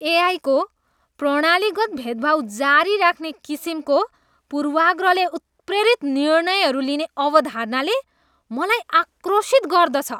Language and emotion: Nepali, disgusted